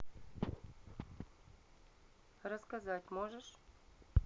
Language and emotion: Russian, neutral